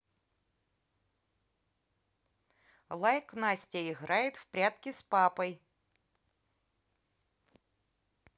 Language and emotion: Russian, positive